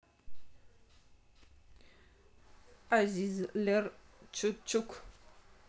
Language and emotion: Russian, neutral